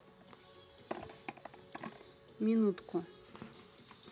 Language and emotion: Russian, neutral